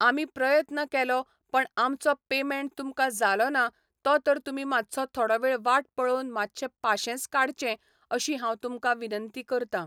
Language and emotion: Goan Konkani, neutral